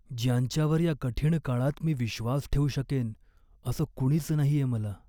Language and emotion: Marathi, sad